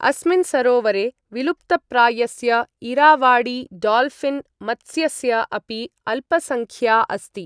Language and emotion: Sanskrit, neutral